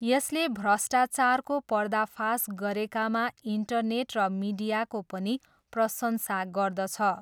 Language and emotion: Nepali, neutral